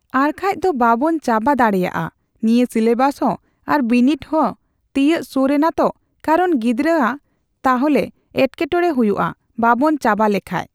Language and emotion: Santali, neutral